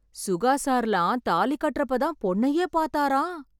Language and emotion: Tamil, surprised